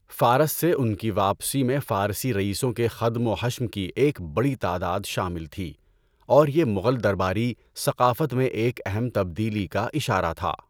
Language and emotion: Urdu, neutral